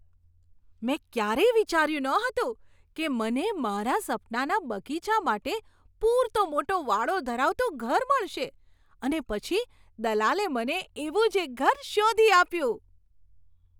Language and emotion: Gujarati, surprised